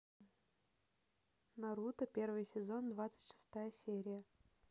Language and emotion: Russian, neutral